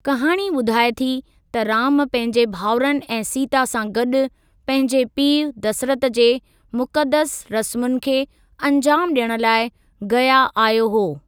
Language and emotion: Sindhi, neutral